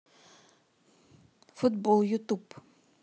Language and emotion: Russian, neutral